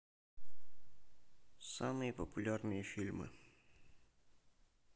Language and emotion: Russian, neutral